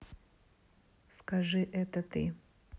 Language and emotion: Russian, neutral